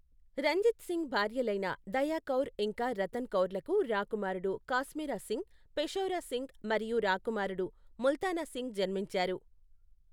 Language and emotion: Telugu, neutral